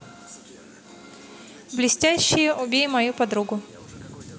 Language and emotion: Russian, neutral